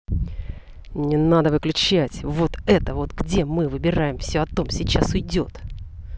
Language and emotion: Russian, angry